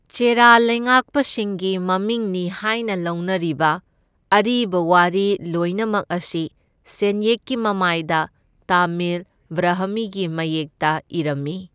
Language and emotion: Manipuri, neutral